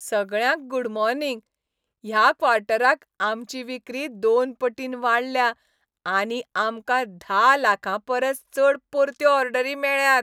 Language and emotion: Goan Konkani, happy